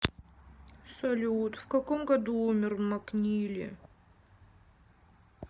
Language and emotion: Russian, sad